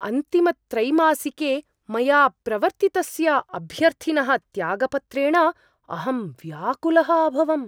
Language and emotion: Sanskrit, surprised